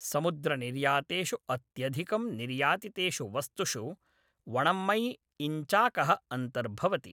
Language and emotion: Sanskrit, neutral